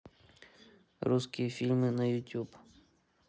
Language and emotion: Russian, neutral